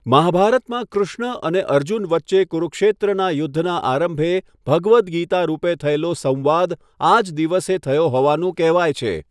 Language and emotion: Gujarati, neutral